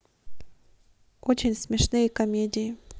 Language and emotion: Russian, neutral